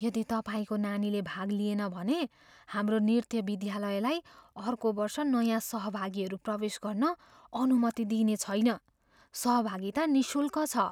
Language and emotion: Nepali, fearful